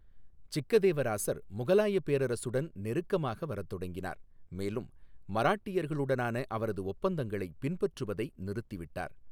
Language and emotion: Tamil, neutral